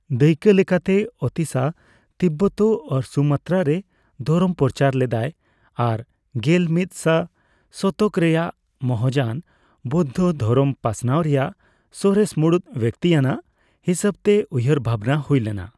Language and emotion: Santali, neutral